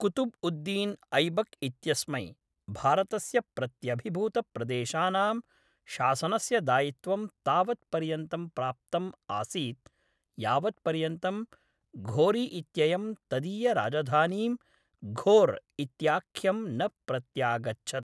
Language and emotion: Sanskrit, neutral